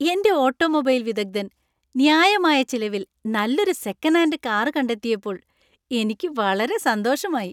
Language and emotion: Malayalam, happy